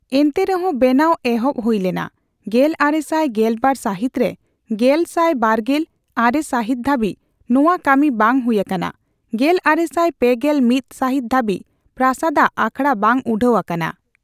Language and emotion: Santali, neutral